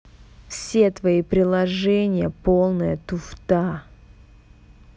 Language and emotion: Russian, angry